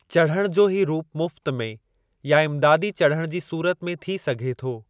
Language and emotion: Sindhi, neutral